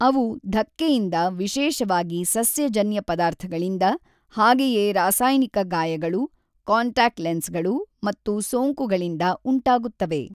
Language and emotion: Kannada, neutral